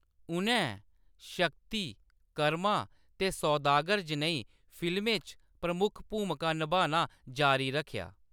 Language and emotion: Dogri, neutral